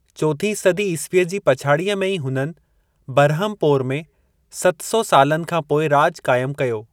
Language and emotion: Sindhi, neutral